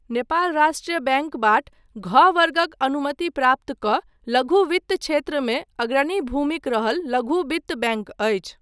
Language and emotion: Maithili, neutral